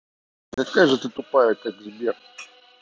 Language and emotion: Russian, angry